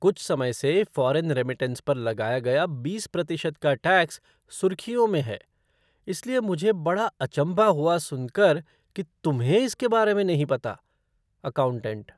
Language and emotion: Hindi, surprised